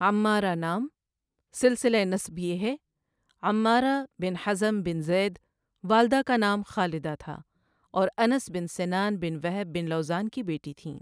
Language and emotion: Urdu, neutral